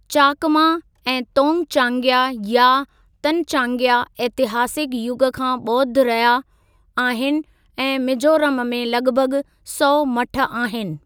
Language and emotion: Sindhi, neutral